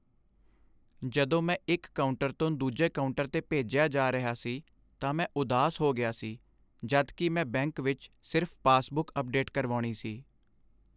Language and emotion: Punjabi, sad